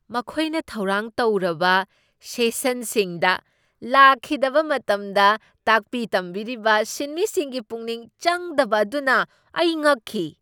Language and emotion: Manipuri, surprised